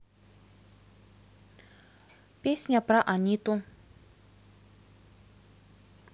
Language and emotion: Russian, neutral